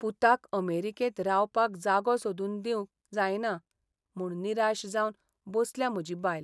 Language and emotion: Goan Konkani, sad